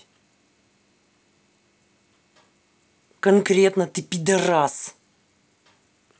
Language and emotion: Russian, angry